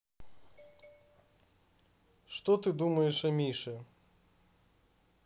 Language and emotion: Russian, neutral